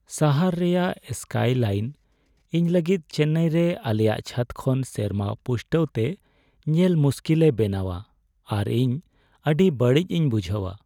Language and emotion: Santali, sad